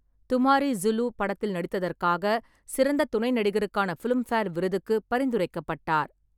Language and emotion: Tamil, neutral